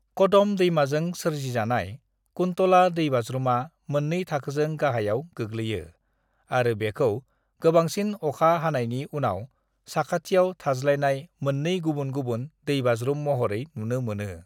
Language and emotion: Bodo, neutral